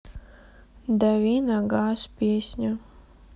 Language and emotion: Russian, sad